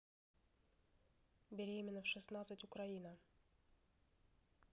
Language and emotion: Russian, neutral